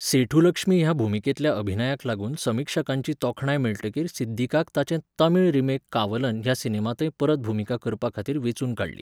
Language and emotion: Goan Konkani, neutral